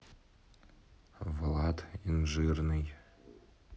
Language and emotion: Russian, neutral